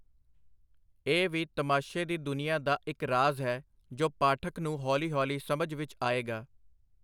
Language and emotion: Punjabi, neutral